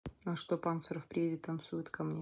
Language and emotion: Russian, neutral